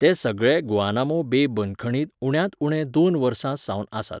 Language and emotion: Goan Konkani, neutral